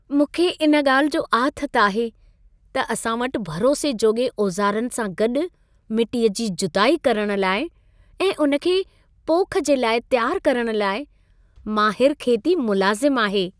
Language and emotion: Sindhi, happy